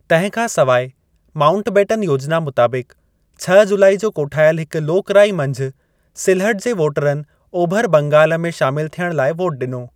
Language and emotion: Sindhi, neutral